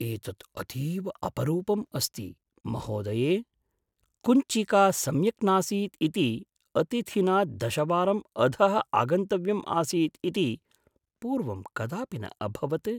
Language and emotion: Sanskrit, surprised